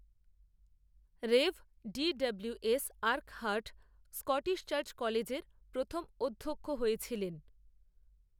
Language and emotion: Bengali, neutral